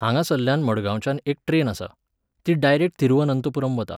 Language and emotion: Goan Konkani, neutral